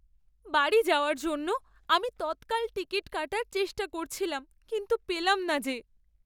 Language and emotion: Bengali, sad